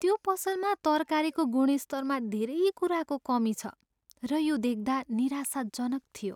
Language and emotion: Nepali, sad